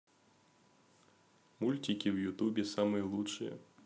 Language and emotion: Russian, positive